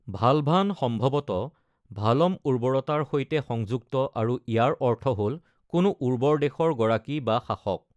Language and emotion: Assamese, neutral